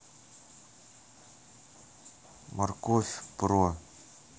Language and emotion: Russian, neutral